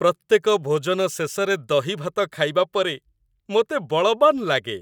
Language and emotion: Odia, happy